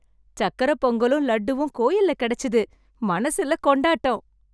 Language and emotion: Tamil, happy